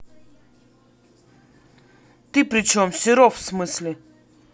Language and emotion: Russian, angry